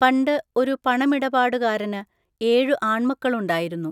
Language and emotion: Malayalam, neutral